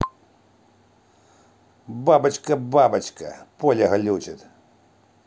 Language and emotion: Russian, angry